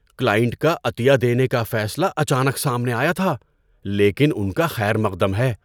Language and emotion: Urdu, surprised